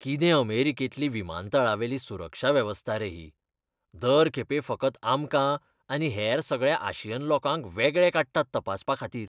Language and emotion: Goan Konkani, disgusted